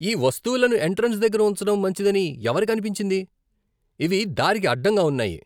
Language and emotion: Telugu, disgusted